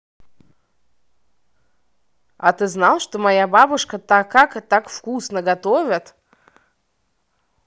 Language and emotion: Russian, positive